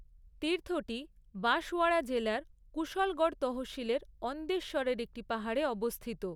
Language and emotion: Bengali, neutral